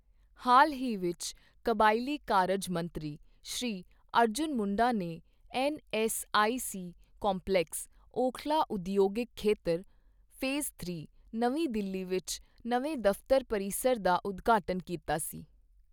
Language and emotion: Punjabi, neutral